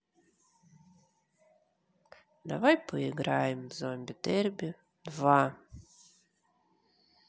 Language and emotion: Russian, neutral